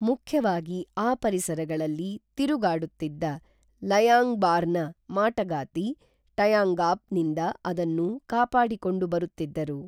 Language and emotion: Kannada, neutral